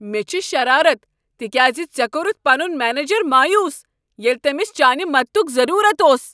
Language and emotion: Kashmiri, angry